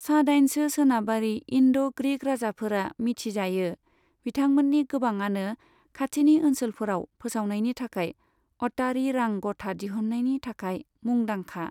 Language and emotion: Bodo, neutral